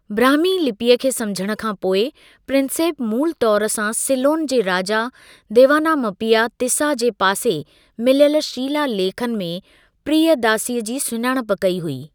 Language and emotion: Sindhi, neutral